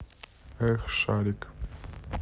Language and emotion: Russian, neutral